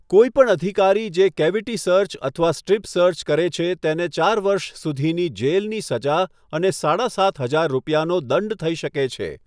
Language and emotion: Gujarati, neutral